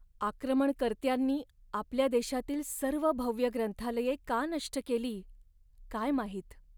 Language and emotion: Marathi, sad